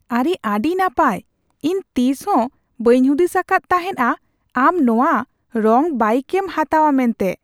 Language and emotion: Santali, surprised